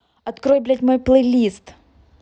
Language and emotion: Russian, angry